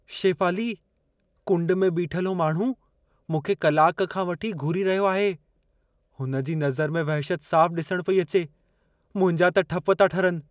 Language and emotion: Sindhi, fearful